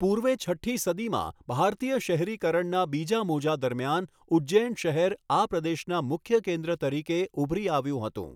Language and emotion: Gujarati, neutral